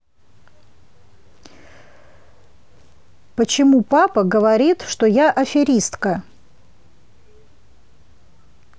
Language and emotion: Russian, neutral